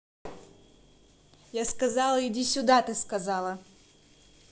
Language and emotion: Russian, angry